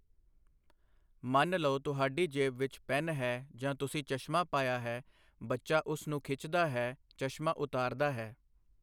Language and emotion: Punjabi, neutral